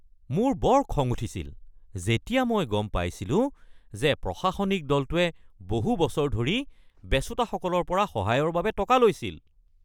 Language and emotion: Assamese, angry